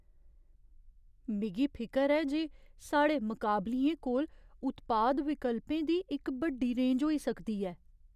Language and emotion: Dogri, fearful